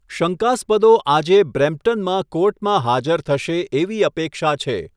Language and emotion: Gujarati, neutral